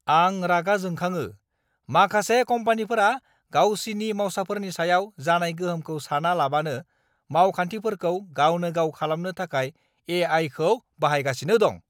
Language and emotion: Bodo, angry